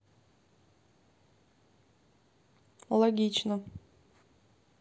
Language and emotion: Russian, neutral